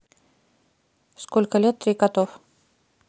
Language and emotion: Russian, neutral